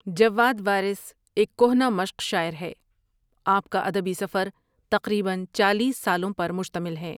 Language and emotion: Urdu, neutral